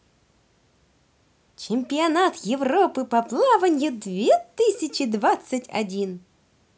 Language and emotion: Russian, positive